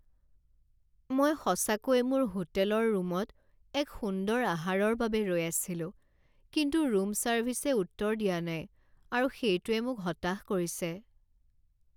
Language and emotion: Assamese, sad